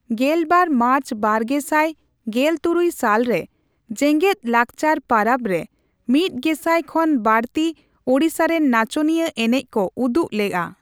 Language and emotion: Santali, neutral